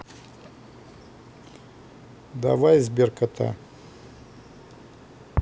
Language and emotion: Russian, neutral